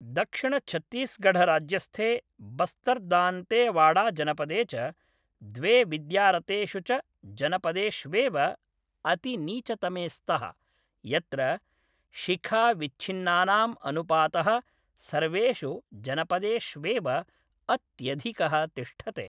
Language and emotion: Sanskrit, neutral